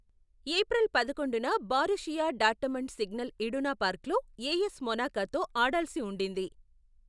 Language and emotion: Telugu, neutral